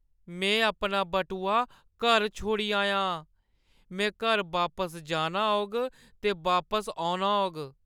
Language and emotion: Dogri, sad